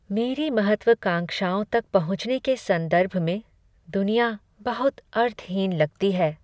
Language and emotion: Hindi, sad